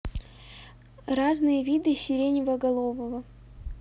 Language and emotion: Russian, neutral